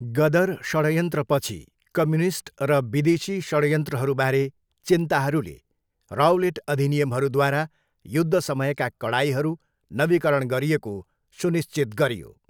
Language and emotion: Nepali, neutral